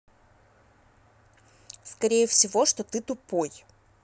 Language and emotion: Russian, neutral